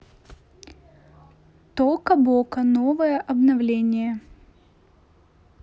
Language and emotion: Russian, neutral